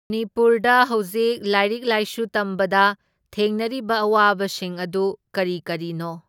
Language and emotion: Manipuri, neutral